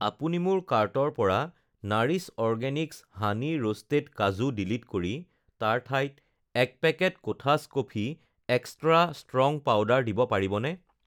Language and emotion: Assamese, neutral